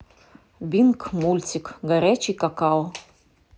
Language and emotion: Russian, neutral